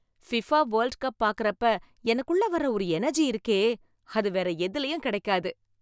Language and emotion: Tamil, happy